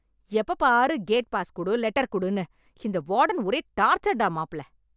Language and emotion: Tamil, angry